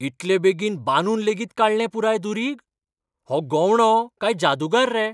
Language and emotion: Goan Konkani, surprised